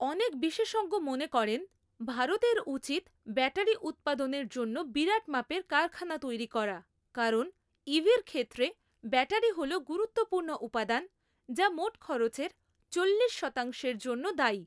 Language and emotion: Bengali, neutral